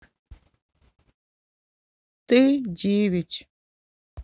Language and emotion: Russian, sad